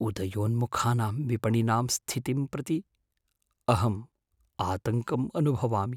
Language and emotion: Sanskrit, fearful